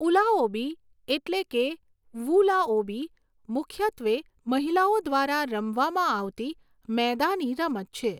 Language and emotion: Gujarati, neutral